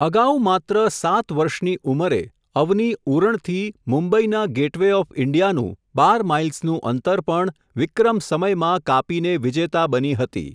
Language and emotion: Gujarati, neutral